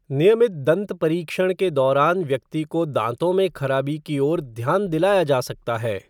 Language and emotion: Hindi, neutral